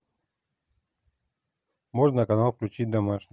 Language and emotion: Russian, neutral